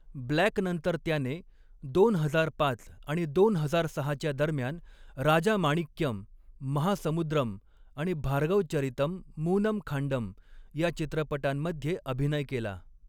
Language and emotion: Marathi, neutral